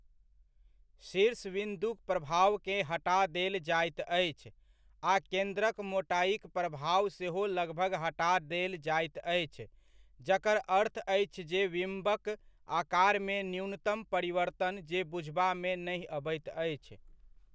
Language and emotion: Maithili, neutral